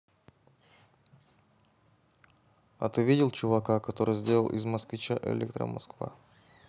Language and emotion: Russian, neutral